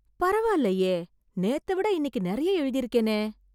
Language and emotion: Tamil, surprised